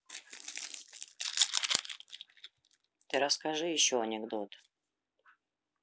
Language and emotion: Russian, neutral